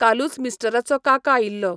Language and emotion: Goan Konkani, neutral